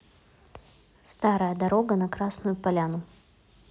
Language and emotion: Russian, neutral